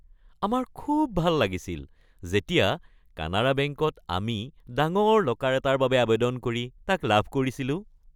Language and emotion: Assamese, happy